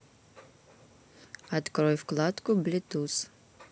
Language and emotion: Russian, neutral